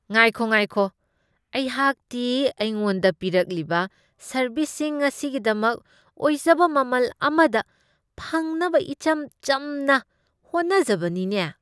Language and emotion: Manipuri, disgusted